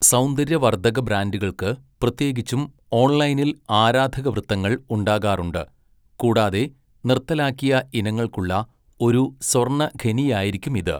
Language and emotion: Malayalam, neutral